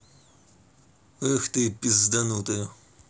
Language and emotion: Russian, angry